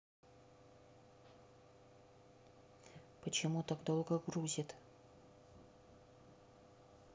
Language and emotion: Russian, neutral